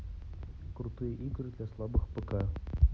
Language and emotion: Russian, neutral